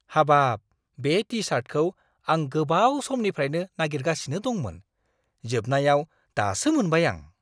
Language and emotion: Bodo, surprised